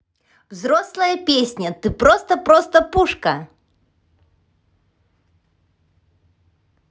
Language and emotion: Russian, positive